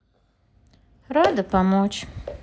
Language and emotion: Russian, sad